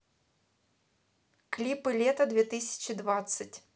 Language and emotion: Russian, neutral